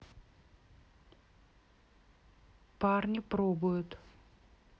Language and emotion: Russian, neutral